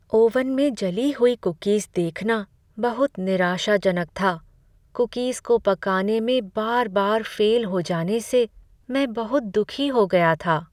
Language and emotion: Hindi, sad